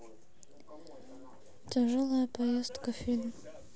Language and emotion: Russian, sad